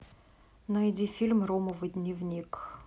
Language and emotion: Russian, neutral